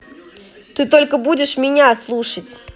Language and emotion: Russian, angry